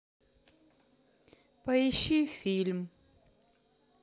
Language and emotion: Russian, sad